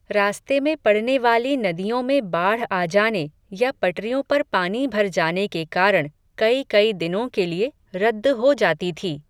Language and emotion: Hindi, neutral